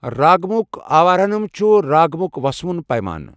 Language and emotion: Kashmiri, neutral